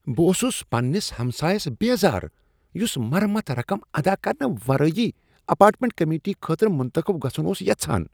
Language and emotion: Kashmiri, disgusted